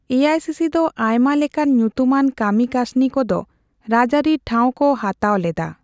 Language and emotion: Santali, neutral